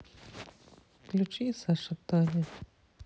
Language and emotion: Russian, sad